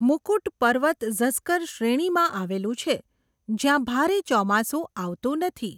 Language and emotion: Gujarati, neutral